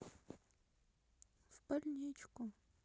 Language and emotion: Russian, sad